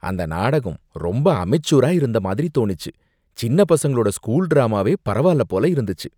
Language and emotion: Tamil, disgusted